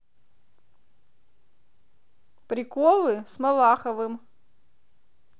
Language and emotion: Russian, positive